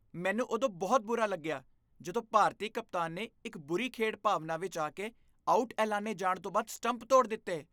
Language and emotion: Punjabi, disgusted